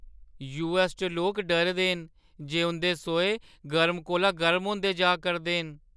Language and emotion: Dogri, fearful